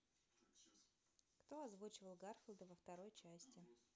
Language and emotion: Russian, neutral